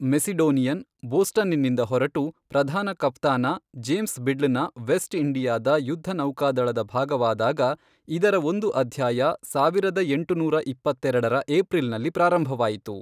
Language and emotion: Kannada, neutral